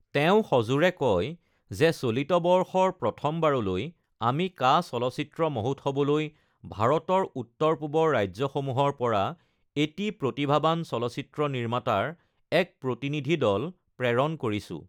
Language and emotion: Assamese, neutral